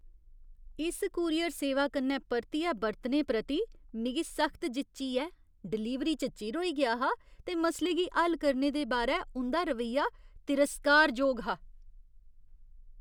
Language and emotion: Dogri, disgusted